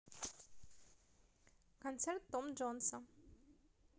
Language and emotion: Russian, positive